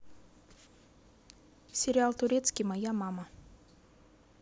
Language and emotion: Russian, neutral